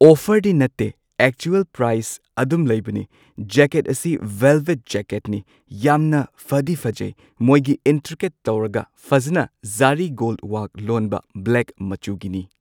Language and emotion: Manipuri, neutral